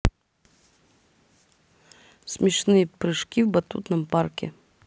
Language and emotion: Russian, neutral